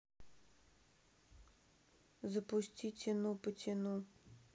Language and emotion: Russian, sad